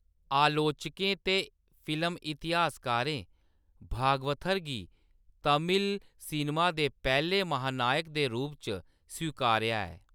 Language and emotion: Dogri, neutral